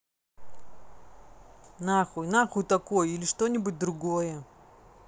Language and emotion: Russian, angry